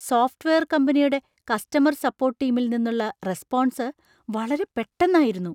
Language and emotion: Malayalam, surprised